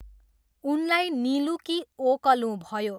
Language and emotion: Nepali, neutral